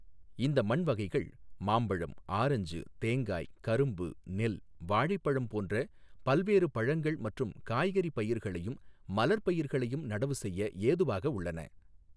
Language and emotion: Tamil, neutral